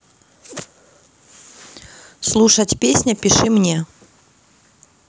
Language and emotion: Russian, neutral